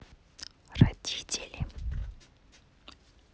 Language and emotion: Russian, neutral